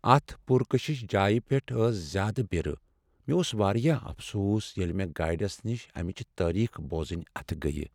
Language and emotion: Kashmiri, sad